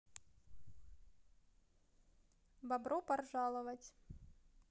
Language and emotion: Russian, neutral